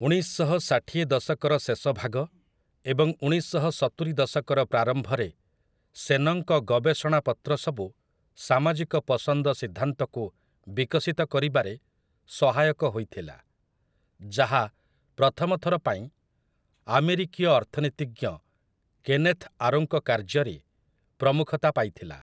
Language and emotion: Odia, neutral